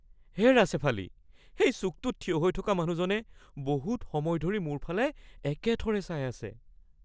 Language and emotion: Assamese, fearful